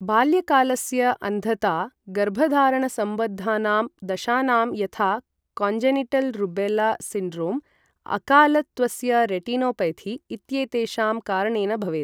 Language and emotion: Sanskrit, neutral